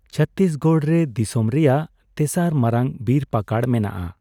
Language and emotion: Santali, neutral